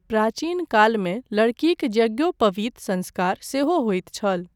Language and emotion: Maithili, neutral